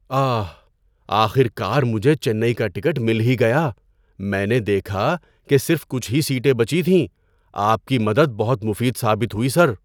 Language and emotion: Urdu, surprised